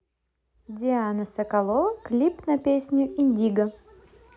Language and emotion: Russian, positive